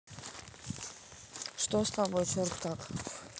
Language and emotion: Russian, neutral